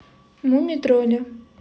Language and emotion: Russian, neutral